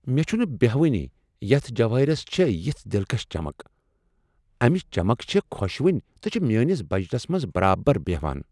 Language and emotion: Kashmiri, surprised